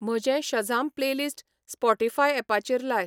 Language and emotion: Goan Konkani, neutral